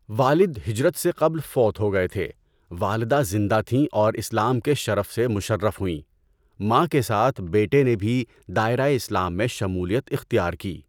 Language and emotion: Urdu, neutral